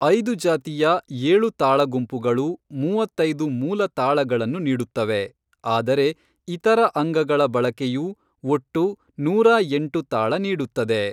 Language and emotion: Kannada, neutral